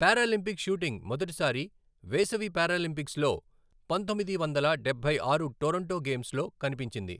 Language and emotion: Telugu, neutral